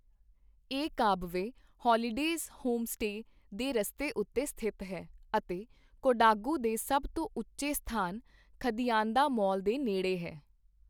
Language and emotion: Punjabi, neutral